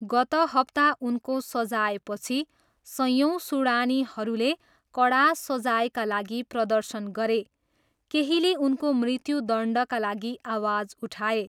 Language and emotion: Nepali, neutral